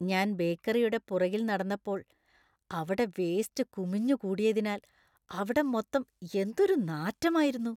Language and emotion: Malayalam, disgusted